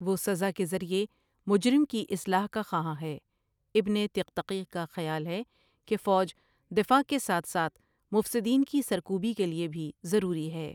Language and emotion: Urdu, neutral